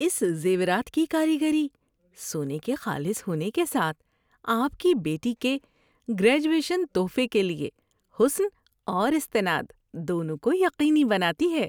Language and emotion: Urdu, happy